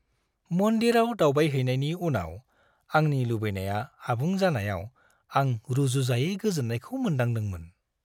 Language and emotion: Bodo, happy